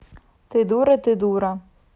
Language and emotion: Russian, neutral